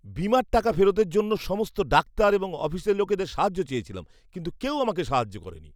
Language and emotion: Bengali, disgusted